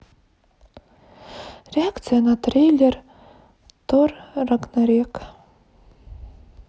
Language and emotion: Russian, sad